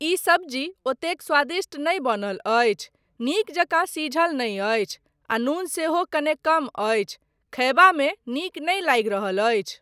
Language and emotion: Maithili, neutral